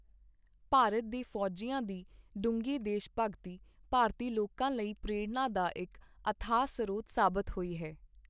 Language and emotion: Punjabi, neutral